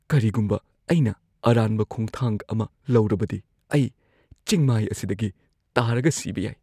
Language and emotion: Manipuri, fearful